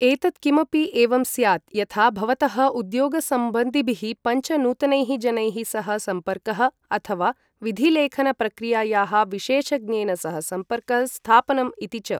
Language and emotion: Sanskrit, neutral